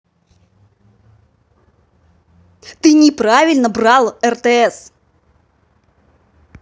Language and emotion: Russian, angry